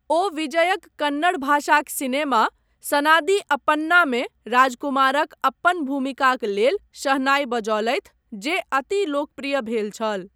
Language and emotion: Maithili, neutral